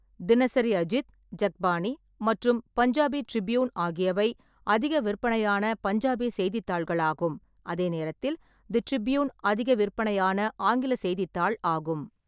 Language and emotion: Tamil, neutral